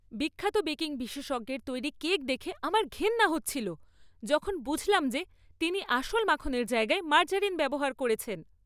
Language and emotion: Bengali, disgusted